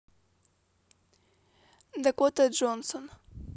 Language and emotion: Russian, neutral